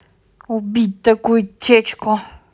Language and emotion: Russian, angry